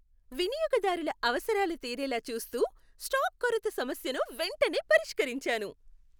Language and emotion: Telugu, happy